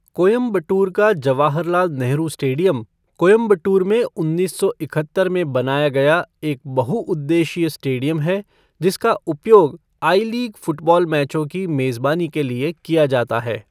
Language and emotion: Hindi, neutral